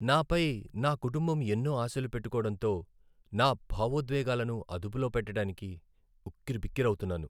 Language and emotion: Telugu, sad